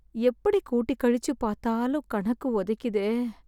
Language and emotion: Tamil, sad